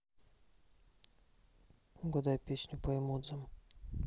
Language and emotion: Russian, neutral